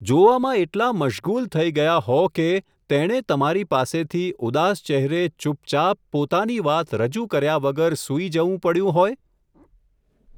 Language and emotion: Gujarati, neutral